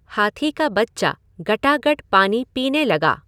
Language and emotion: Hindi, neutral